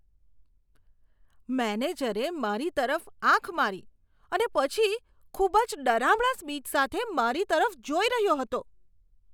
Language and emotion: Gujarati, disgusted